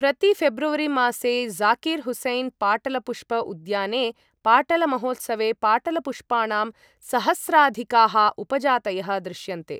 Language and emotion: Sanskrit, neutral